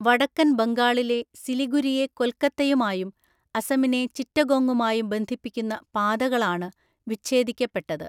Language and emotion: Malayalam, neutral